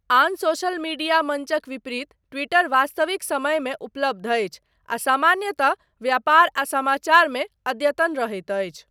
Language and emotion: Maithili, neutral